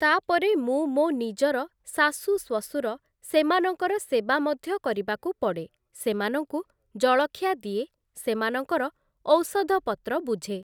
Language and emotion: Odia, neutral